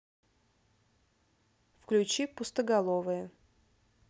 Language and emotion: Russian, neutral